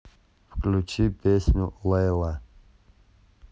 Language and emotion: Russian, neutral